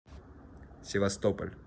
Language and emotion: Russian, neutral